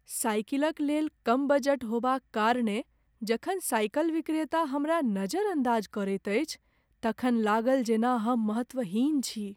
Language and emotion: Maithili, sad